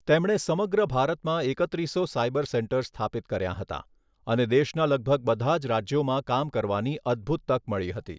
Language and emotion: Gujarati, neutral